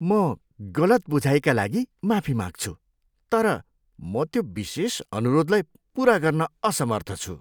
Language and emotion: Nepali, disgusted